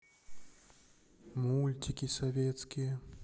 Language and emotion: Russian, sad